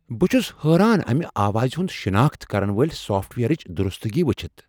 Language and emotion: Kashmiri, surprised